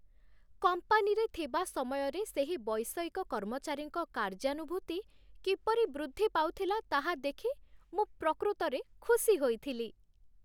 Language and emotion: Odia, happy